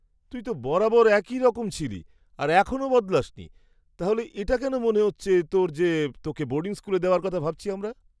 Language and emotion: Bengali, surprised